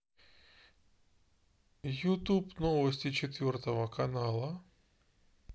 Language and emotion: Russian, neutral